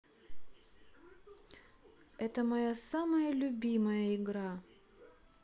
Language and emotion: Russian, neutral